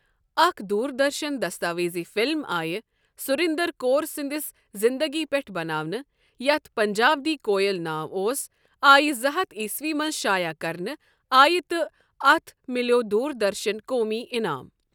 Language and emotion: Kashmiri, neutral